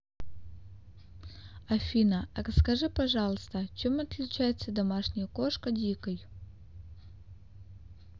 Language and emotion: Russian, neutral